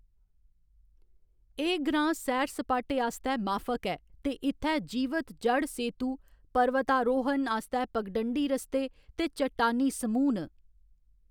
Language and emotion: Dogri, neutral